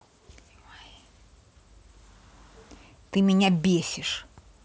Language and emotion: Russian, angry